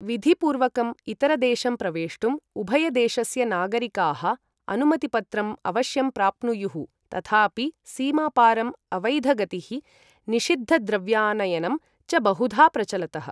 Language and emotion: Sanskrit, neutral